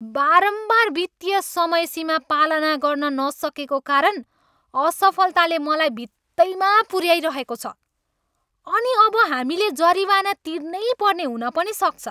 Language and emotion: Nepali, angry